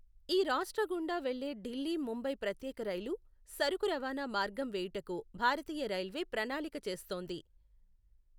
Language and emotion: Telugu, neutral